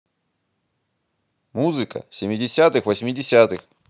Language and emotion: Russian, angry